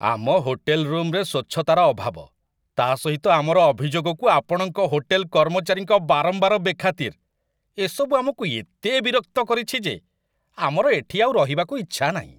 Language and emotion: Odia, disgusted